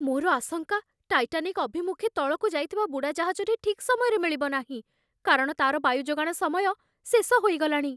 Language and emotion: Odia, fearful